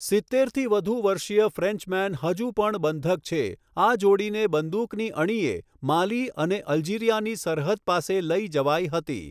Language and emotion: Gujarati, neutral